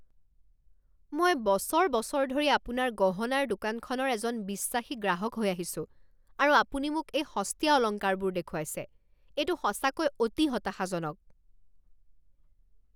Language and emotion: Assamese, angry